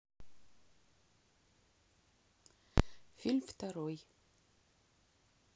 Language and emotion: Russian, neutral